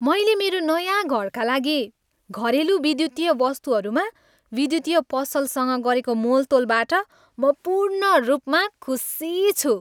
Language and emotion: Nepali, happy